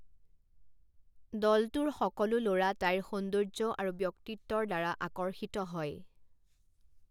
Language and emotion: Assamese, neutral